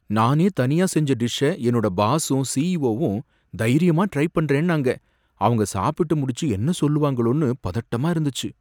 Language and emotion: Tamil, fearful